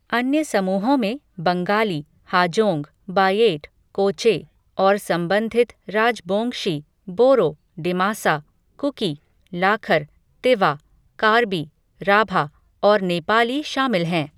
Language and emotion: Hindi, neutral